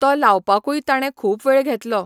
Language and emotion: Goan Konkani, neutral